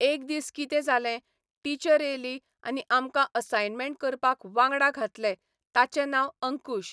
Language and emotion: Goan Konkani, neutral